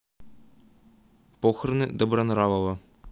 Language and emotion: Russian, neutral